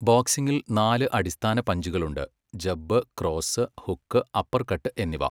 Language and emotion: Malayalam, neutral